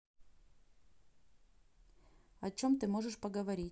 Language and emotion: Russian, neutral